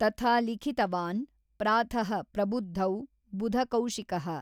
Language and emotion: Kannada, neutral